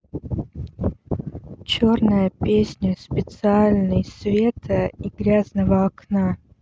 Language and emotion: Russian, neutral